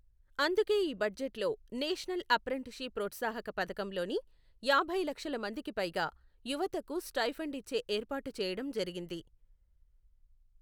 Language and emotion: Telugu, neutral